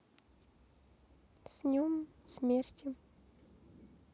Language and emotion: Russian, sad